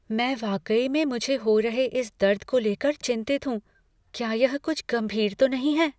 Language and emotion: Hindi, fearful